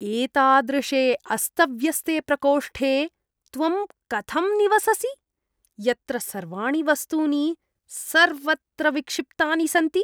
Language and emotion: Sanskrit, disgusted